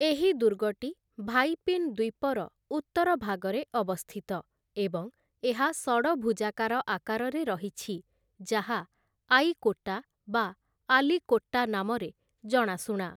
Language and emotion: Odia, neutral